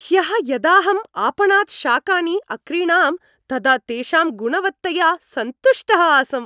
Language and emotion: Sanskrit, happy